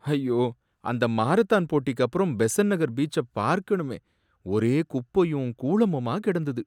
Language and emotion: Tamil, sad